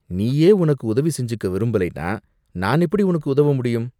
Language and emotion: Tamil, disgusted